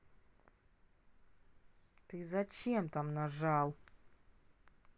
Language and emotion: Russian, angry